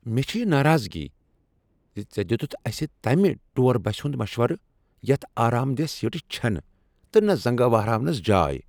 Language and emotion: Kashmiri, angry